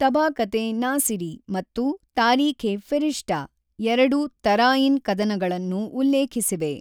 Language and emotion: Kannada, neutral